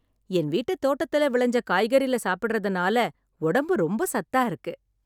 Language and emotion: Tamil, happy